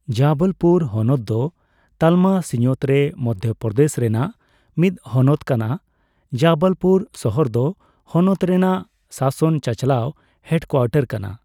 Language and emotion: Santali, neutral